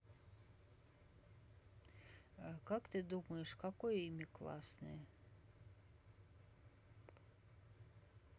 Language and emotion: Russian, neutral